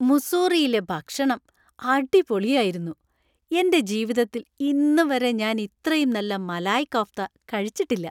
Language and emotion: Malayalam, happy